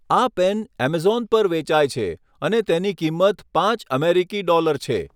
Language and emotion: Gujarati, neutral